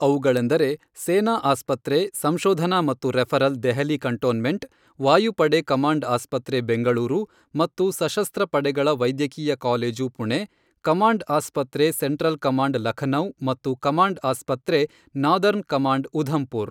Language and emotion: Kannada, neutral